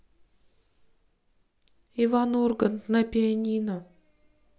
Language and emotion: Russian, sad